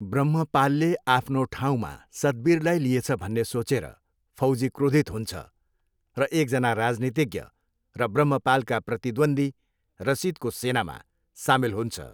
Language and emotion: Nepali, neutral